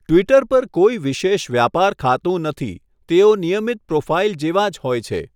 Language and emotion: Gujarati, neutral